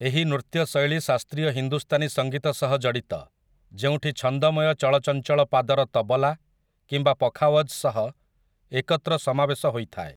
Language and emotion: Odia, neutral